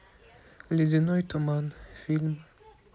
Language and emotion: Russian, neutral